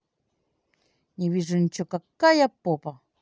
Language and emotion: Russian, positive